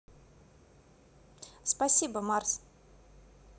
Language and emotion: Russian, neutral